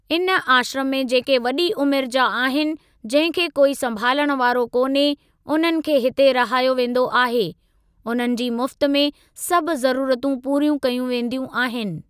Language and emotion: Sindhi, neutral